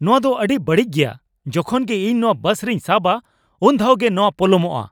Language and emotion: Santali, angry